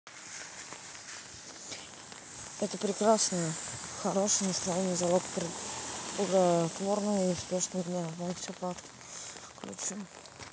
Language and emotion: Russian, neutral